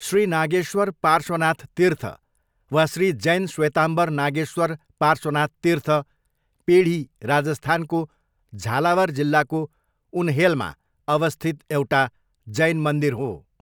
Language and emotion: Nepali, neutral